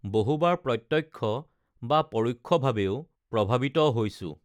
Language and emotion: Assamese, neutral